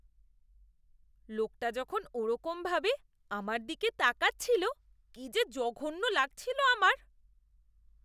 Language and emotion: Bengali, disgusted